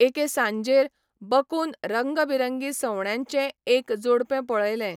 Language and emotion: Goan Konkani, neutral